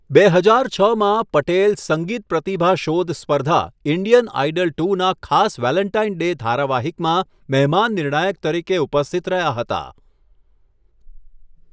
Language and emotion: Gujarati, neutral